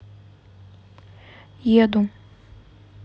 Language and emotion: Russian, neutral